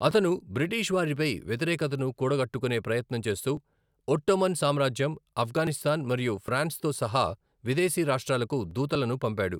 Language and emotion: Telugu, neutral